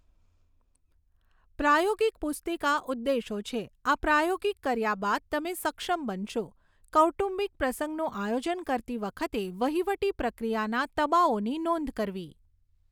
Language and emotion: Gujarati, neutral